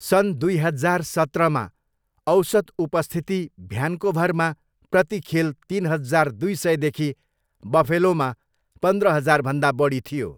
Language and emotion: Nepali, neutral